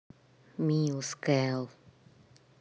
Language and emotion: Russian, neutral